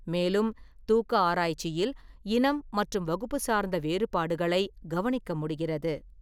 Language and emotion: Tamil, neutral